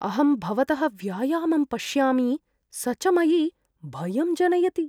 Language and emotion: Sanskrit, fearful